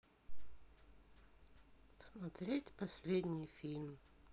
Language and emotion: Russian, sad